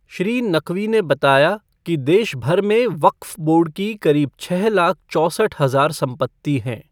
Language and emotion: Hindi, neutral